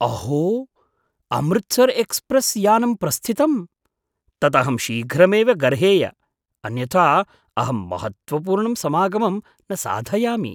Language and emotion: Sanskrit, surprised